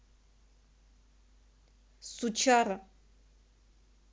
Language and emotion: Russian, angry